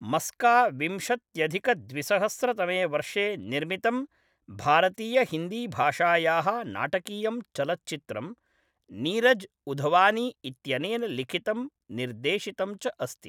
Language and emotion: Sanskrit, neutral